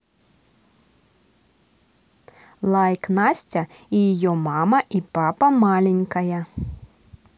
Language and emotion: Russian, positive